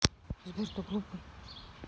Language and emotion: Russian, neutral